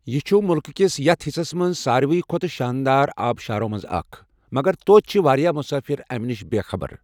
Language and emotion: Kashmiri, neutral